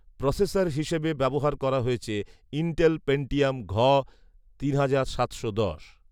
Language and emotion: Bengali, neutral